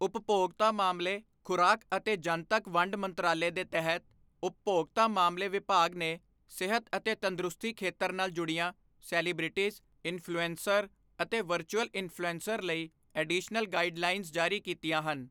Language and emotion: Punjabi, neutral